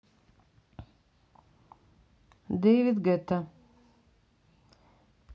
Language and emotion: Russian, neutral